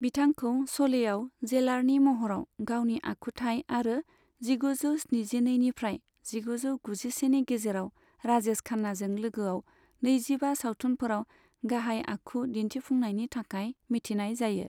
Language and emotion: Bodo, neutral